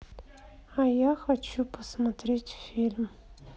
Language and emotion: Russian, sad